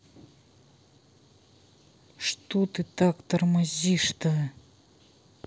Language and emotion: Russian, angry